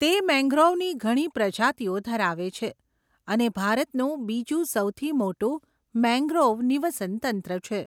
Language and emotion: Gujarati, neutral